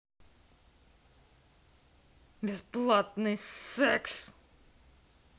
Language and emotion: Russian, angry